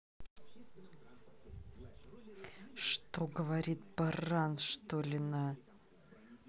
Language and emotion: Russian, angry